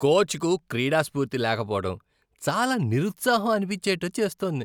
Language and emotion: Telugu, disgusted